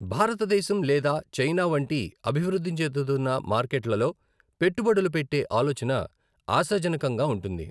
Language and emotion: Telugu, neutral